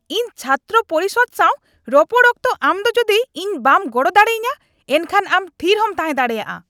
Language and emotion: Santali, angry